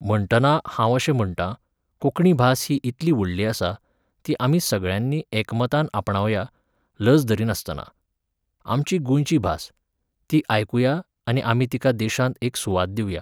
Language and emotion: Goan Konkani, neutral